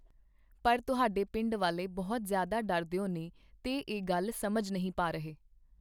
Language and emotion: Punjabi, neutral